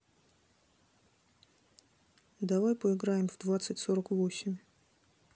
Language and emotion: Russian, neutral